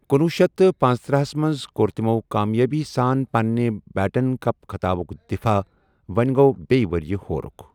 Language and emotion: Kashmiri, neutral